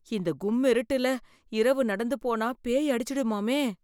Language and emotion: Tamil, fearful